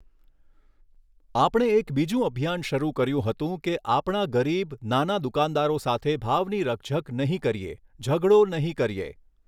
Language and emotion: Gujarati, neutral